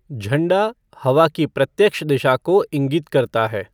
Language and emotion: Hindi, neutral